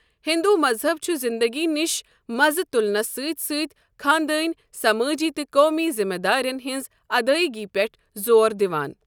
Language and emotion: Kashmiri, neutral